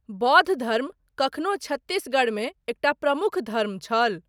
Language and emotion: Maithili, neutral